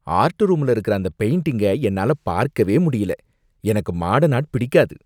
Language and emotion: Tamil, disgusted